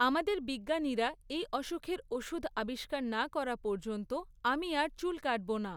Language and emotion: Bengali, neutral